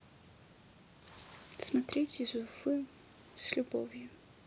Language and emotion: Russian, neutral